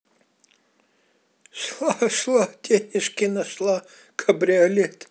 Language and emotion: Russian, positive